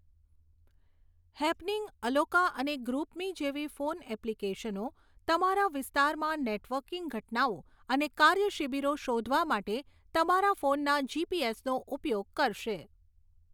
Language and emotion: Gujarati, neutral